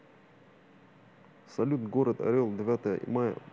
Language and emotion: Russian, neutral